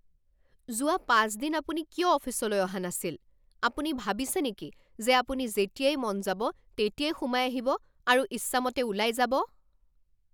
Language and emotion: Assamese, angry